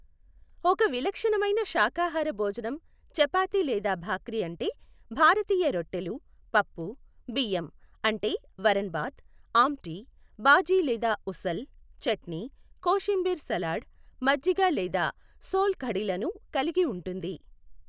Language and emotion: Telugu, neutral